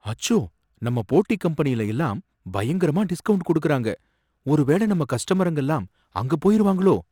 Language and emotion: Tamil, fearful